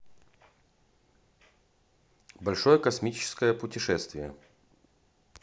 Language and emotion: Russian, neutral